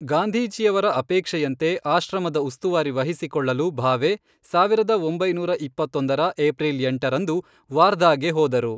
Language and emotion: Kannada, neutral